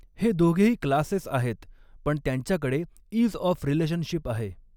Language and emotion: Marathi, neutral